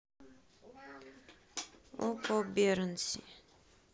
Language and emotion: Russian, neutral